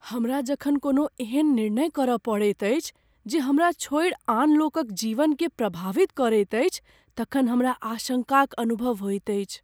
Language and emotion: Maithili, fearful